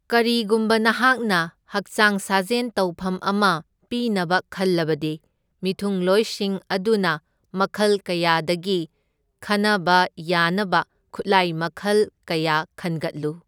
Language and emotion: Manipuri, neutral